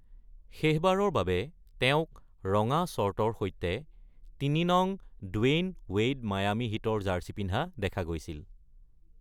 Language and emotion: Assamese, neutral